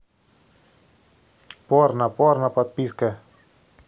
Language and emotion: Russian, neutral